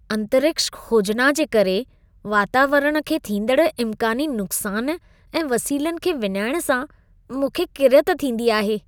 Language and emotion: Sindhi, disgusted